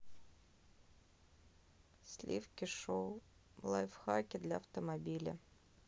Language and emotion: Russian, sad